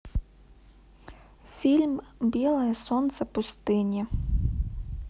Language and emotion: Russian, neutral